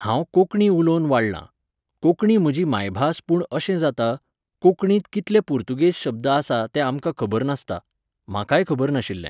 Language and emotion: Goan Konkani, neutral